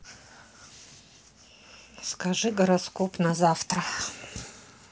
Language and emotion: Russian, neutral